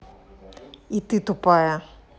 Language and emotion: Russian, angry